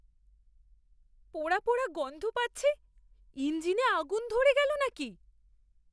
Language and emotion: Bengali, fearful